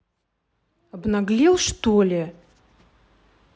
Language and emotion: Russian, angry